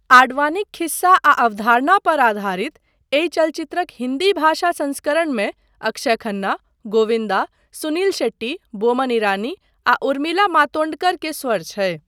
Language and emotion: Maithili, neutral